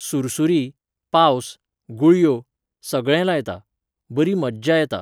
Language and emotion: Goan Konkani, neutral